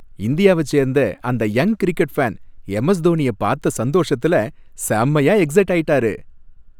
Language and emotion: Tamil, happy